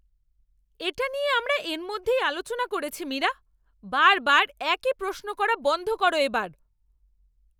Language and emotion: Bengali, angry